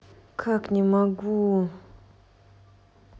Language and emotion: Russian, neutral